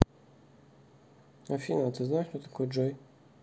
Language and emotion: Russian, neutral